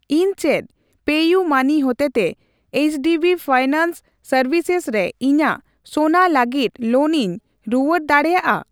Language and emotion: Santali, neutral